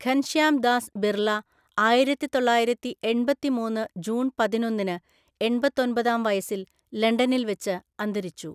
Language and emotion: Malayalam, neutral